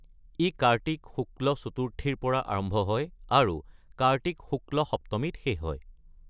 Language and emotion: Assamese, neutral